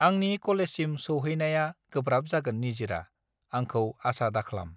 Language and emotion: Bodo, neutral